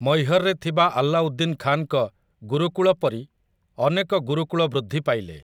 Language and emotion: Odia, neutral